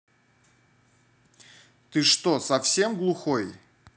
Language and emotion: Russian, angry